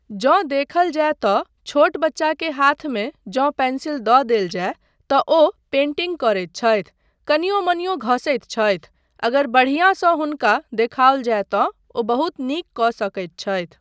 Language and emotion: Maithili, neutral